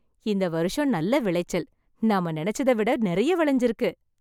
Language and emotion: Tamil, happy